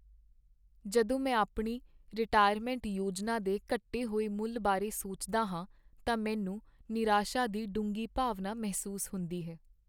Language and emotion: Punjabi, sad